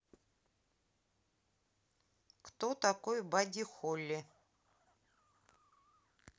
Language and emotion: Russian, neutral